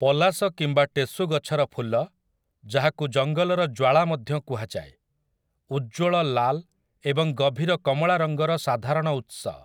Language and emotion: Odia, neutral